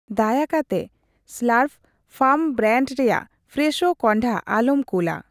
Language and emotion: Santali, neutral